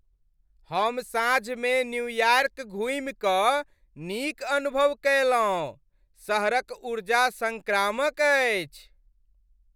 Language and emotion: Maithili, happy